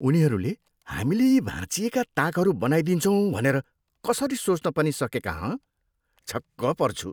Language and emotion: Nepali, disgusted